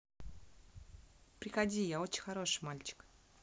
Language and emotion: Russian, neutral